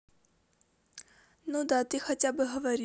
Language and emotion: Russian, neutral